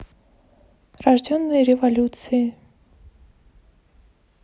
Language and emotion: Russian, neutral